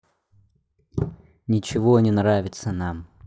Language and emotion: Russian, neutral